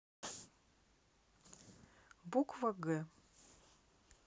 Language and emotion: Russian, neutral